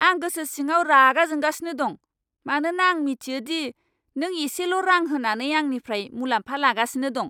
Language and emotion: Bodo, angry